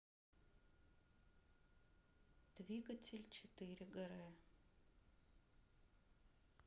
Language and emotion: Russian, neutral